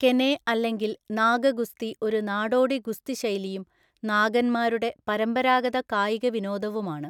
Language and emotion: Malayalam, neutral